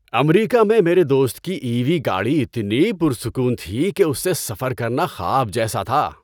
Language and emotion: Urdu, happy